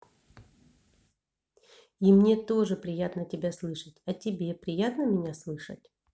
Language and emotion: Russian, neutral